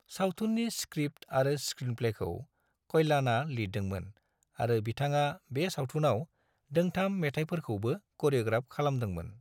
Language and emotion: Bodo, neutral